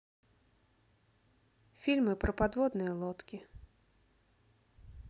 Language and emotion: Russian, neutral